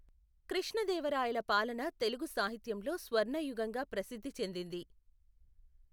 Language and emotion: Telugu, neutral